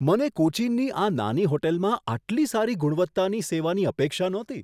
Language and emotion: Gujarati, surprised